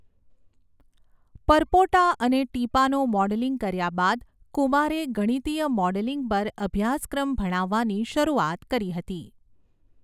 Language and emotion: Gujarati, neutral